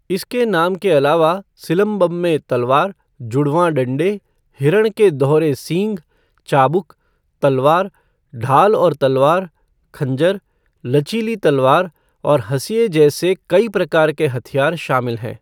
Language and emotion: Hindi, neutral